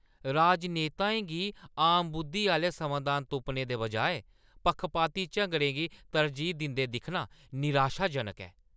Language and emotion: Dogri, angry